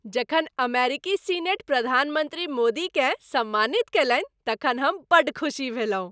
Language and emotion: Maithili, happy